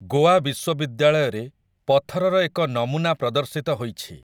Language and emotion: Odia, neutral